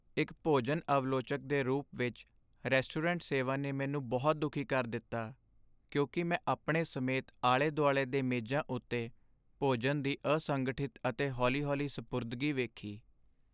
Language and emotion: Punjabi, sad